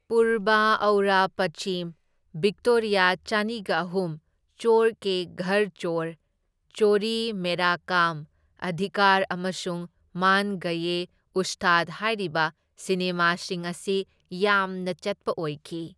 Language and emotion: Manipuri, neutral